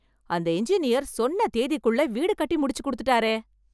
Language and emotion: Tamil, surprised